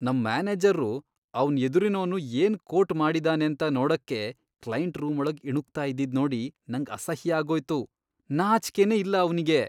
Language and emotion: Kannada, disgusted